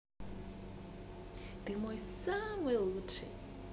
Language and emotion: Russian, positive